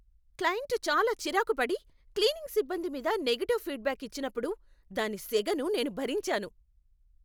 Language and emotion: Telugu, angry